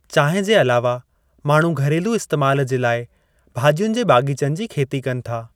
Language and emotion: Sindhi, neutral